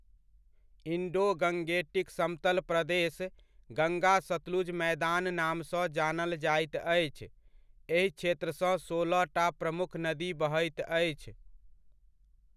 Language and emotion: Maithili, neutral